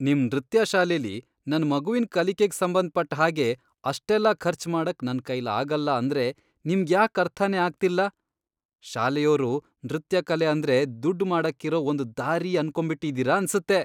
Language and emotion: Kannada, disgusted